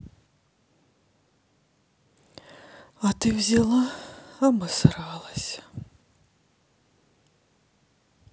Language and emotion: Russian, sad